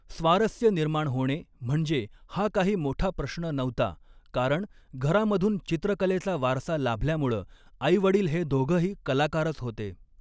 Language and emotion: Marathi, neutral